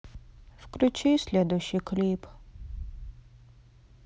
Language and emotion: Russian, sad